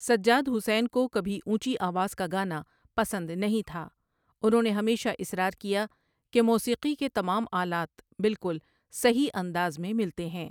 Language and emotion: Urdu, neutral